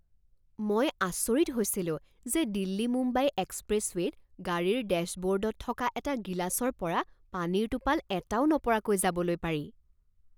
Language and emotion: Assamese, surprised